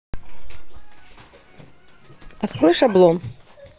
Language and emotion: Russian, neutral